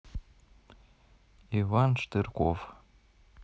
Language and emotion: Russian, neutral